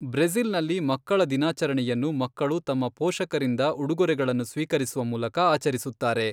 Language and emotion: Kannada, neutral